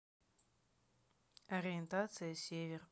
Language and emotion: Russian, neutral